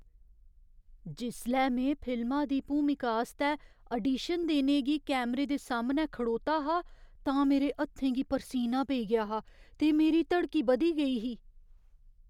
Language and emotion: Dogri, fearful